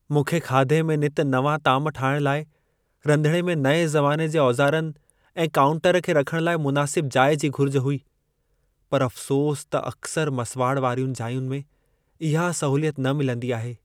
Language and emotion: Sindhi, sad